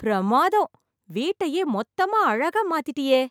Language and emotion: Tamil, happy